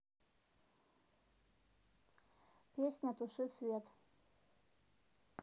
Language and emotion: Russian, neutral